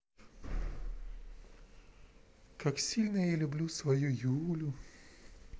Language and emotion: Russian, neutral